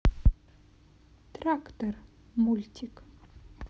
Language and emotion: Russian, neutral